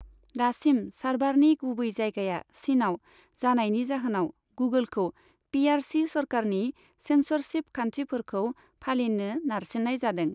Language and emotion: Bodo, neutral